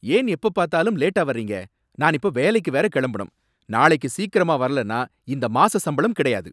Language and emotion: Tamil, angry